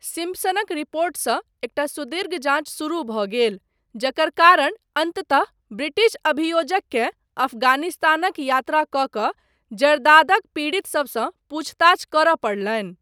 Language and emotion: Maithili, neutral